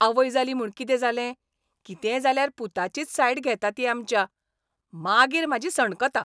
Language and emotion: Goan Konkani, angry